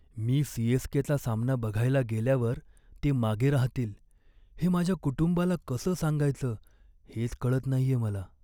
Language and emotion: Marathi, sad